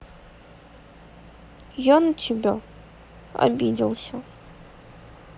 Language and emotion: Russian, sad